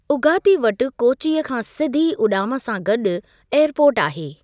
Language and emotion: Sindhi, neutral